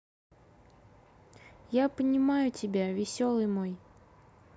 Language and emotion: Russian, sad